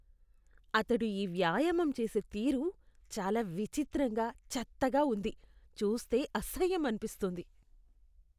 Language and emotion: Telugu, disgusted